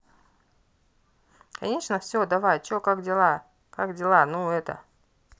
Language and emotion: Russian, neutral